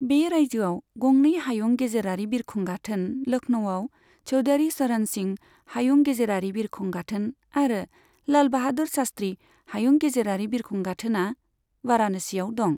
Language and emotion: Bodo, neutral